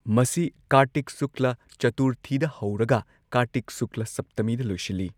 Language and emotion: Manipuri, neutral